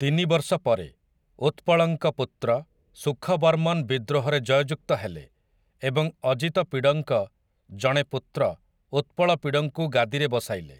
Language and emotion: Odia, neutral